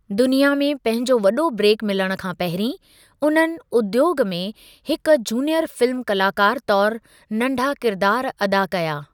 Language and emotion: Sindhi, neutral